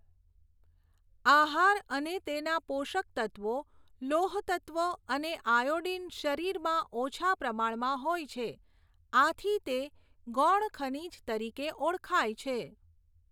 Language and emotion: Gujarati, neutral